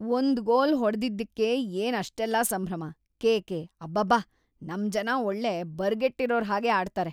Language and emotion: Kannada, disgusted